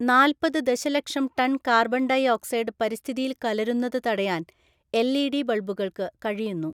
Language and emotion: Malayalam, neutral